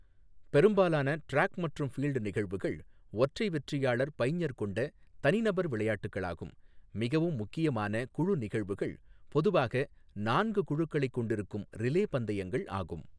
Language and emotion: Tamil, neutral